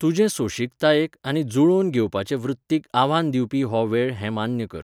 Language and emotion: Goan Konkani, neutral